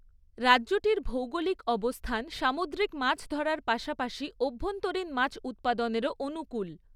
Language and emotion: Bengali, neutral